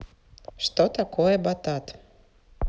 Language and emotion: Russian, neutral